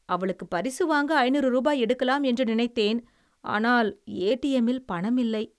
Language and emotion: Tamil, sad